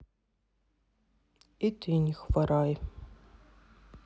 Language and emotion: Russian, sad